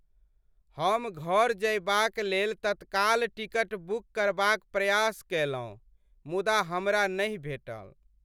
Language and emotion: Maithili, sad